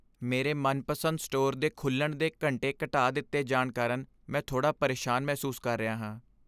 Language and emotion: Punjabi, sad